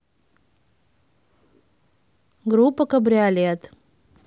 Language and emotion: Russian, neutral